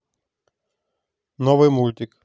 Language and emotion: Russian, neutral